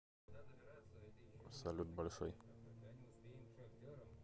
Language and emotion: Russian, neutral